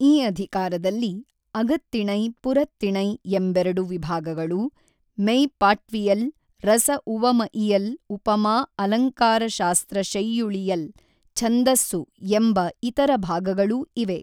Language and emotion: Kannada, neutral